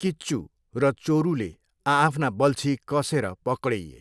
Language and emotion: Nepali, neutral